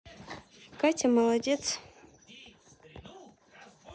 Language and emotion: Russian, neutral